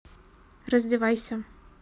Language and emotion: Russian, neutral